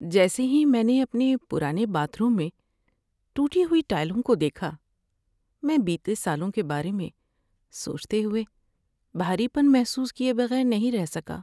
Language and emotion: Urdu, sad